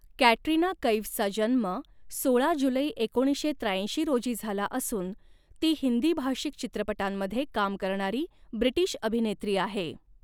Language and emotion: Marathi, neutral